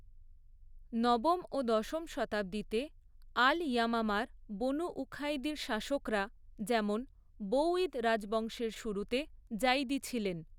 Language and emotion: Bengali, neutral